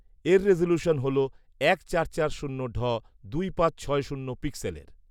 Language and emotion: Bengali, neutral